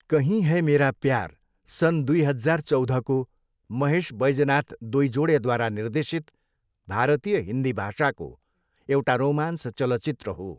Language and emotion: Nepali, neutral